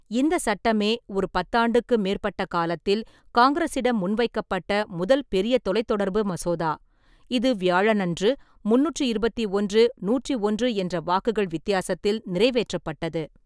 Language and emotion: Tamil, neutral